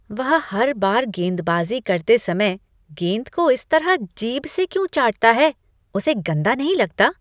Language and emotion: Hindi, disgusted